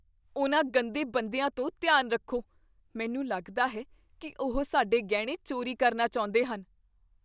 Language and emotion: Punjabi, fearful